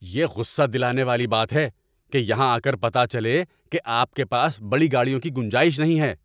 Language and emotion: Urdu, angry